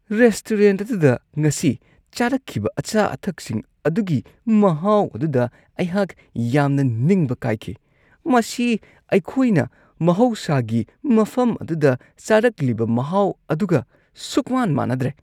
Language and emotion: Manipuri, disgusted